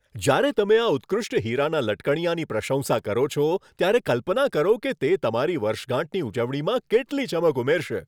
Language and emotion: Gujarati, happy